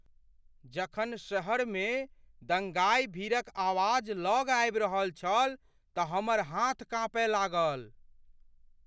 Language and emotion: Maithili, fearful